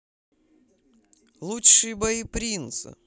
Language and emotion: Russian, positive